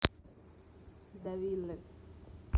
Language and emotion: Russian, neutral